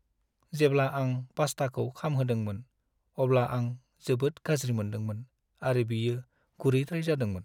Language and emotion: Bodo, sad